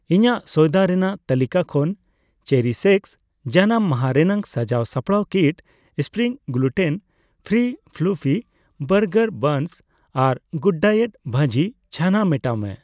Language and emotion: Santali, neutral